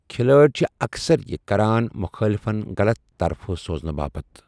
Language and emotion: Kashmiri, neutral